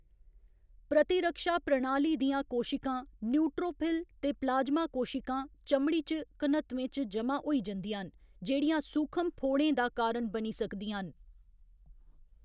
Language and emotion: Dogri, neutral